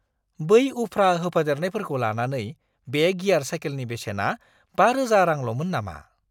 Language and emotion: Bodo, surprised